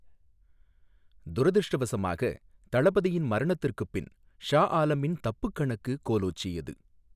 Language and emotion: Tamil, neutral